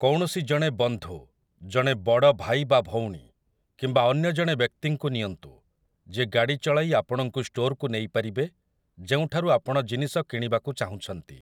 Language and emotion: Odia, neutral